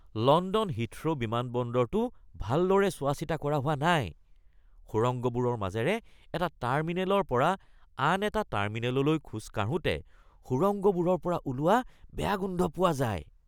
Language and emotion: Assamese, disgusted